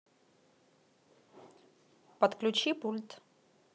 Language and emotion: Russian, neutral